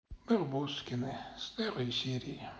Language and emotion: Russian, sad